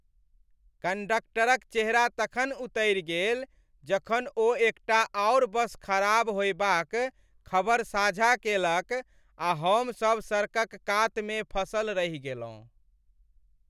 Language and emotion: Maithili, sad